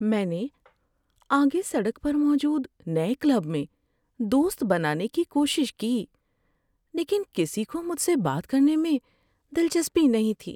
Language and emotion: Urdu, sad